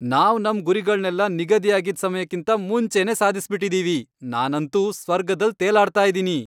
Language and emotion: Kannada, happy